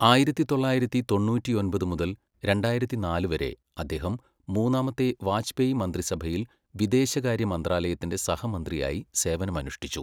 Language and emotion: Malayalam, neutral